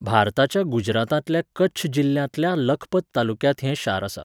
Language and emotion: Goan Konkani, neutral